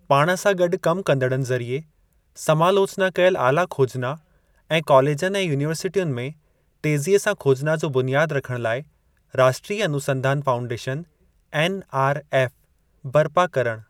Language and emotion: Sindhi, neutral